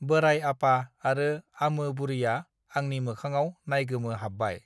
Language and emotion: Bodo, neutral